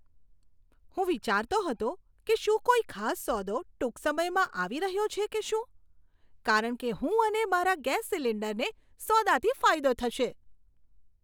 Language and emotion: Gujarati, surprised